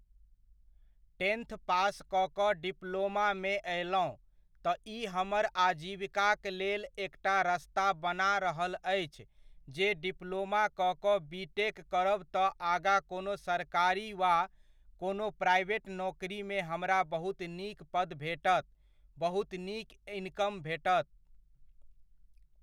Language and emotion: Maithili, neutral